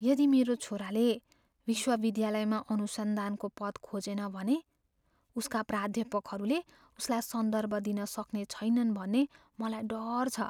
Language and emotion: Nepali, fearful